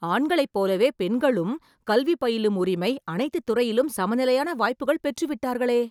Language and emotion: Tamil, surprised